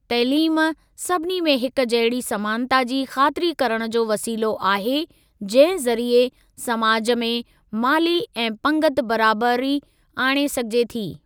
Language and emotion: Sindhi, neutral